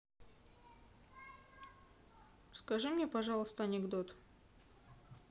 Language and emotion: Russian, neutral